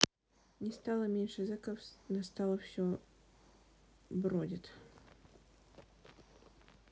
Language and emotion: Russian, sad